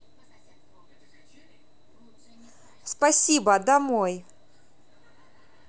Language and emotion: Russian, neutral